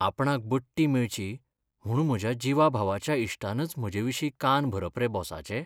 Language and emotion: Goan Konkani, sad